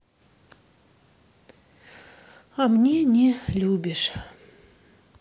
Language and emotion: Russian, sad